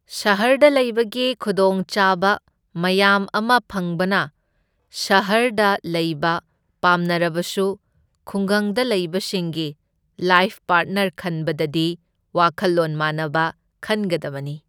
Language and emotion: Manipuri, neutral